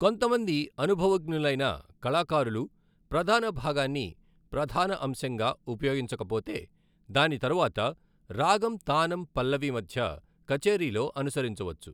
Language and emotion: Telugu, neutral